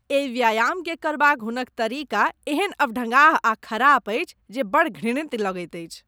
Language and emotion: Maithili, disgusted